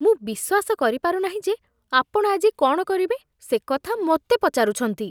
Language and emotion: Odia, disgusted